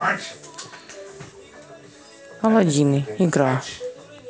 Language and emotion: Russian, neutral